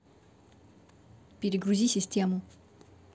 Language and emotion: Russian, angry